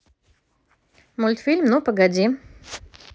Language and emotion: Russian, positive